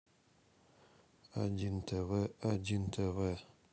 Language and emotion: Russian, neutral